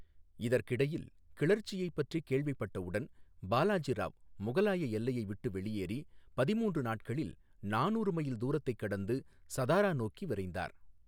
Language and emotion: Tamil, neutral